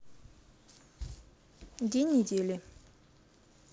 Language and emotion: Russian, neutral